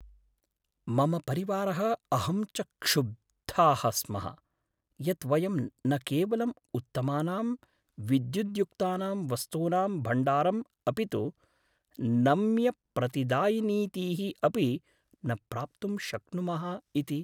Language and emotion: Sanskrit, sad